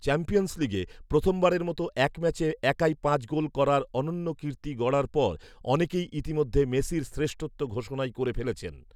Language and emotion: Bengali, neutral